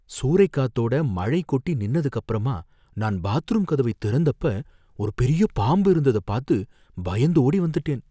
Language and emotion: Tamil, fearful